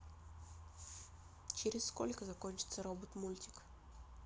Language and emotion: Russian, neutral